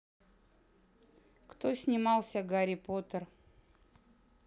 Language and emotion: Russian, neutral